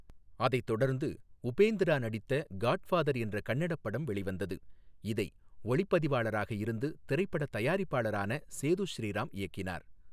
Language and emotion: Tamil, neutral